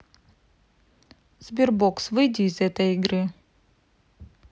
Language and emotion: Russian, neutral